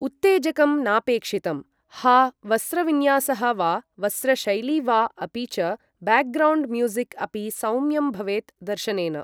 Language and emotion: Sanskrit, neutral